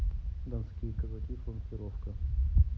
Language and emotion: Russian, neutral